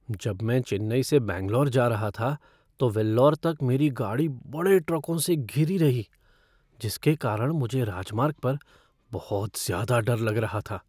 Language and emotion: Hindi, fearful